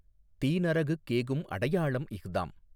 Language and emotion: Tamil, neutral